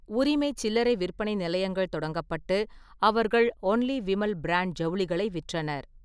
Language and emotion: Tamil, neutral